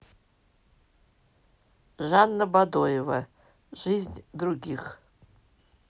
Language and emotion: Russian, neutral